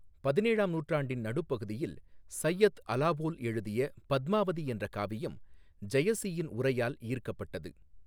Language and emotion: Tamil, neutral